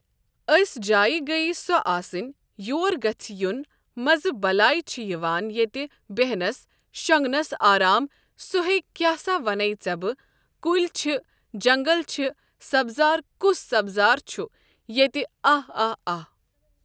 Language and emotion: Kashmiri, neutral